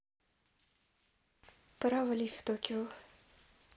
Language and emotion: Russian, neutral